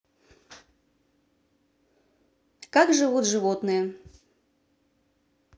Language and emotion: Russian, neutral